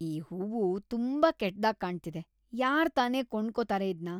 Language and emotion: Kannada, disgusted